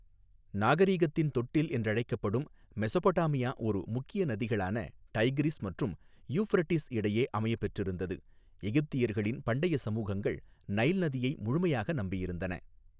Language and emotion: Tamil, neutral